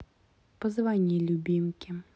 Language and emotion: Russian, neutral